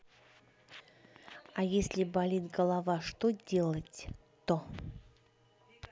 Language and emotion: Russian, neutral